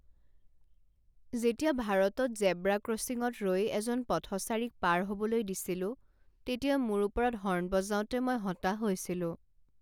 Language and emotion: Assamese, sad